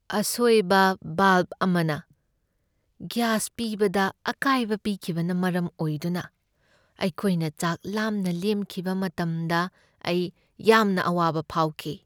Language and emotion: Manipuri, sad